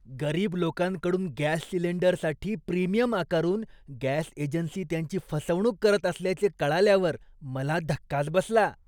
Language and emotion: Marathi, disgusted